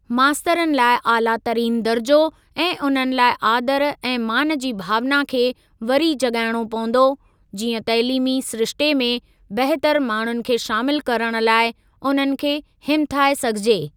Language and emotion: Sindhi, neutral